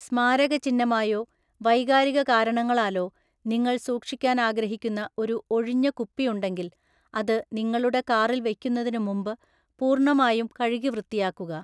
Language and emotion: Malayalam, neutral